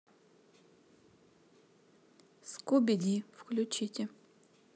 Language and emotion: Russian, neutral